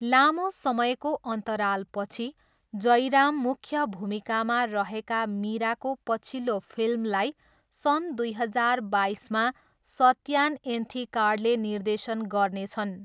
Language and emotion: Nepali, neutral